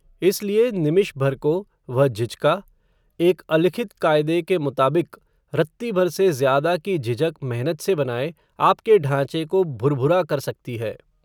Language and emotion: Hindi, neutral